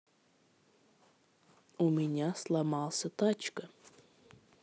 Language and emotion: Russian, neutral